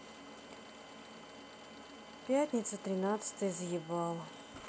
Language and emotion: Russian, sad